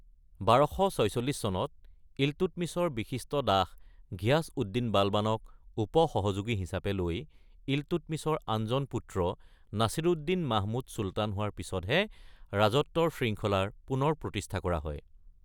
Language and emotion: Assamese, neutral